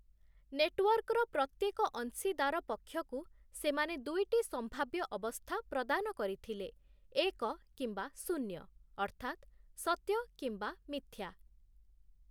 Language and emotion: Odia, neutral